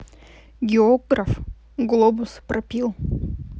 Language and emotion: Russian, neutral